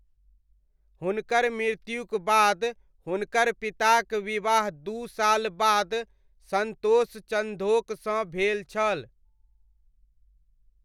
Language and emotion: Maithili, neutral